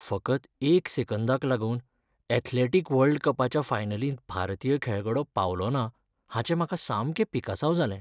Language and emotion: Goan Konkani, sad